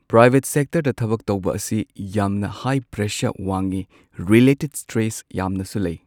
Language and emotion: Manipuri, neutral